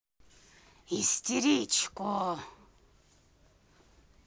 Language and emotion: Russian, angry